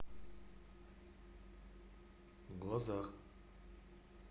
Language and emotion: Russian, neutral